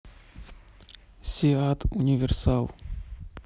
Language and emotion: Russian, neutral